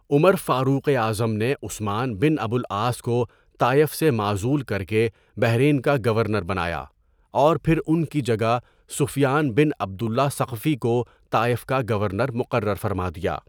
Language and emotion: Urdu, neutral